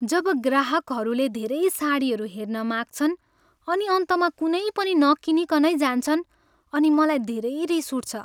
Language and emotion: Nepali, sad